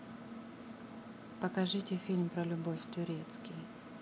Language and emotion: Russian, neutral